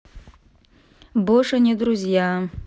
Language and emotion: Russian, sad